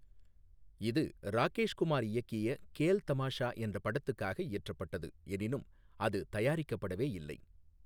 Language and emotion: Tamil, neutral